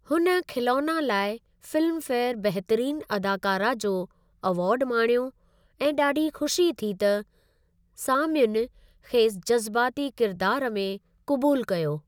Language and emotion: Sindhi, neutral